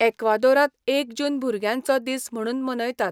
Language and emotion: Goan Konkani, neutral